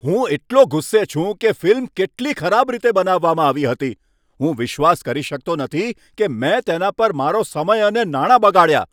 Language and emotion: Gujarati, angry